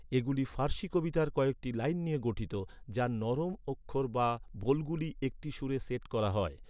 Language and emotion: Bengali, neutral